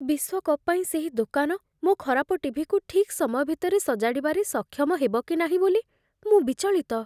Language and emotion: Odia, fearful